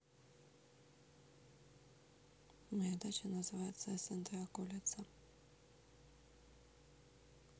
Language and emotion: Russian, neutral